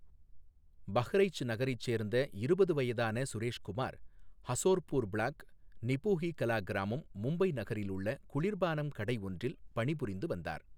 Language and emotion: Tamil, neutral